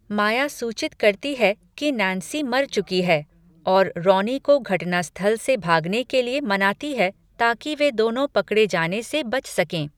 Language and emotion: Hindi, neutral